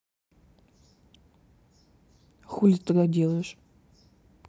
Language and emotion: Russian, neutral